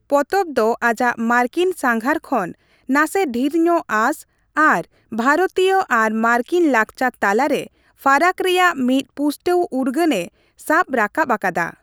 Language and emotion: Santali, neutral